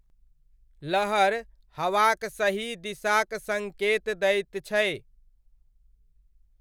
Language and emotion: Maithili, neutral